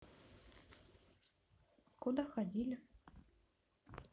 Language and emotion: Russian, neutral